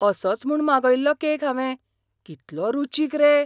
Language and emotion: Goan Konkani, surprised